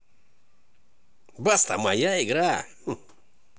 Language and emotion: Russian, positive